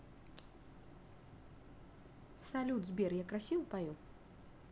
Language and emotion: Russian, neutral